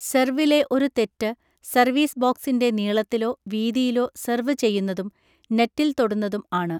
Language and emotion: Malayalam, neutral